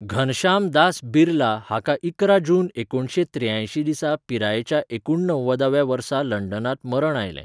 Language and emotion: Goan Konkani, neutral